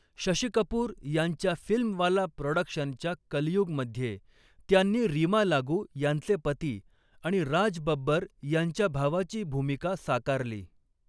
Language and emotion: Marathi, neutral